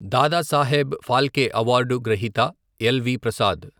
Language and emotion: Telugu, neutral